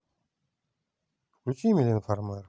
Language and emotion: Russian, neutral